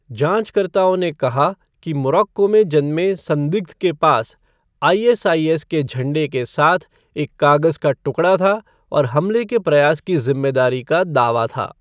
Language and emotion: Hindi, neutral